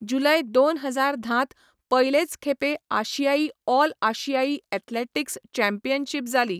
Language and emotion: Goan Konkani, neutral